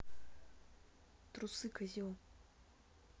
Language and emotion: Russian, angry